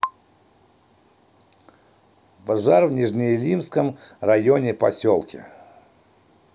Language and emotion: Russian, neutral